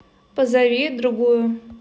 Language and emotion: Russian, neutral